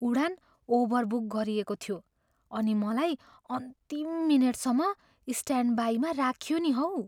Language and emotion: Nepali, fearful